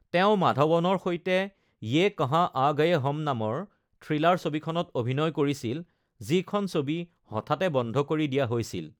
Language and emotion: Assamese, neutral